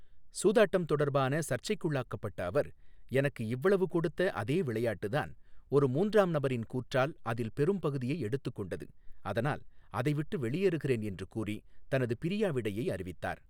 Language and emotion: Tamil, neutral